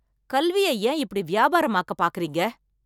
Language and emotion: Tamil, angry